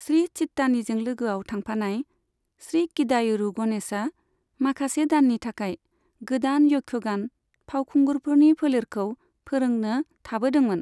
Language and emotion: Bodo, neutral